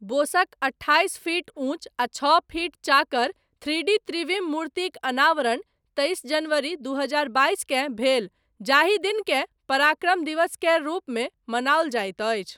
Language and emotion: Maithili, neutral